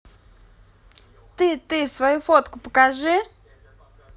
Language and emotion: Russian, positive